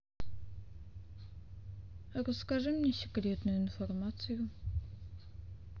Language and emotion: Russian, sad